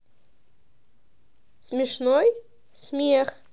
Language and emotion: Russian, positive